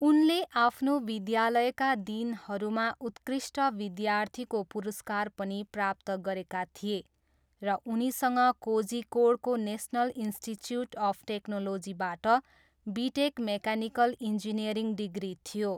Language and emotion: Nepali, neutral